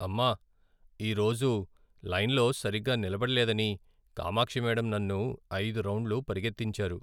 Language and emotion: Telugu, sad